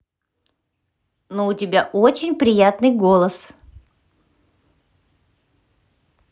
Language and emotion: Russian, positive